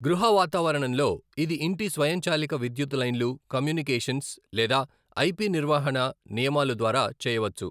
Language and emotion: Telugu, neutral